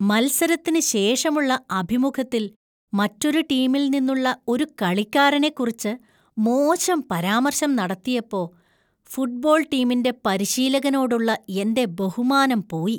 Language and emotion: Malayalam, disgusted